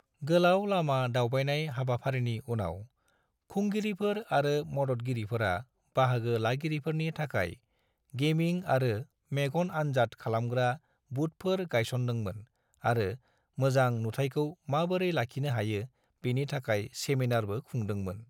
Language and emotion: Bodo, neutral